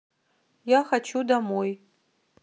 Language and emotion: Russian, neutral